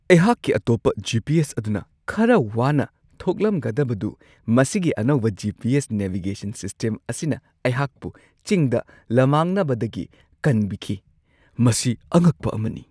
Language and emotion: Manipuri, surprised